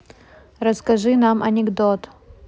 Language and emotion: Russian, neutral